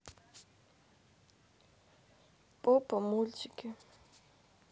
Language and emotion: Russian, sad